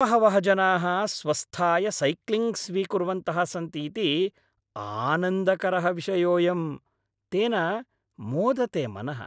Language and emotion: Sanskrit, happy